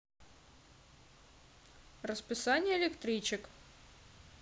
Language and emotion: Russian, neutral